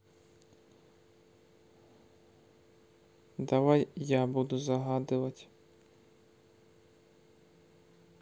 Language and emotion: Russian, neutral